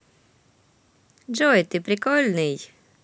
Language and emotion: Russian, positive